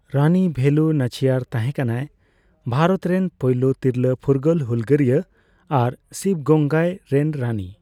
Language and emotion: Santali, neutral